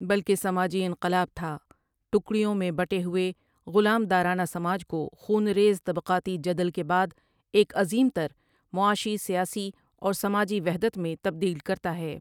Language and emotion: Urdu, neutral